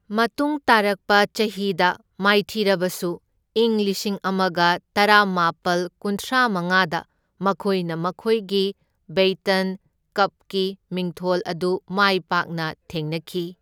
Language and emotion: Manipuri, neutral